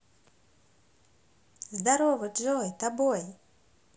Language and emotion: Russian, positive